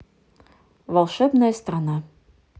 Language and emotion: Russian, neutral